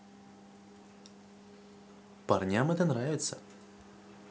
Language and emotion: Russian, positive